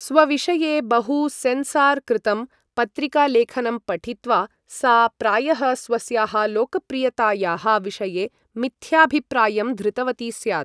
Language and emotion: Sanskrit, neutral